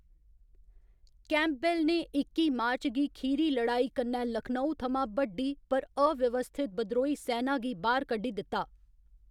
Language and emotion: Dogri, neutral